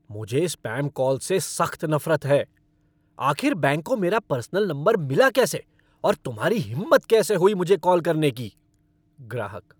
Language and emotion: Hindi, angry